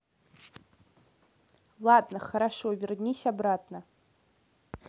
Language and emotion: Russian, neutral